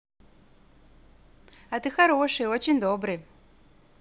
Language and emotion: Russian, positive